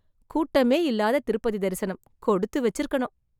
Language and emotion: Tamil, surprised